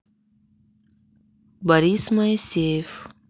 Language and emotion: Russian, neutral